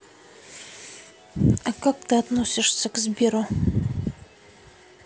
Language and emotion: Russian, neutral